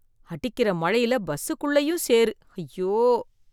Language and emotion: Tamil, disgusted